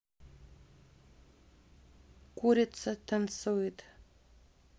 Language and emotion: Russian, neutral